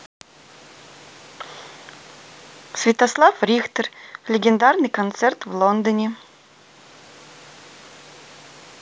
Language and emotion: Russian, neutral